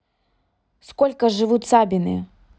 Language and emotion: Russian, neutral